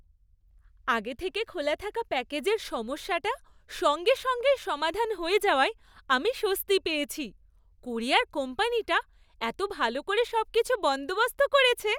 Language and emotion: Bengali, happy